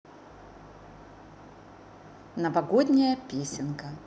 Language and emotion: Russian, positive